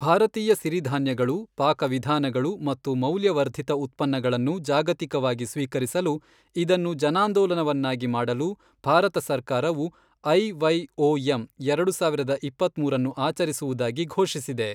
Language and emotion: Kannada, neutral